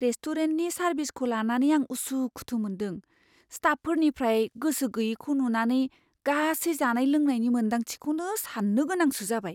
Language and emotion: Bodo, fearful